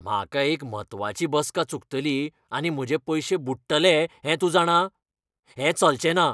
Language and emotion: Goan Konkani, angry